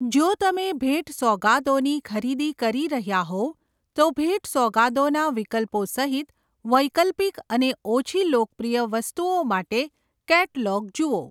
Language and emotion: Gujarati, neutral